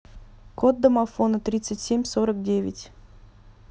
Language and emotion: Russian, neutral